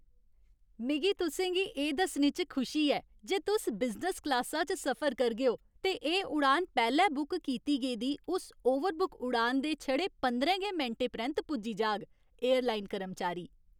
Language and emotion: Dogri, happy